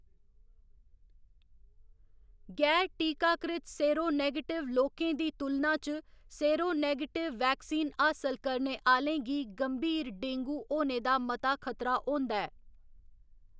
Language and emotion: Dogri, neutral